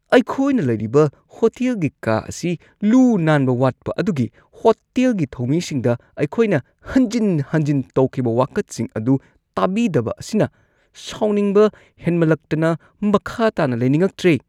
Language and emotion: Manipuri, disgusted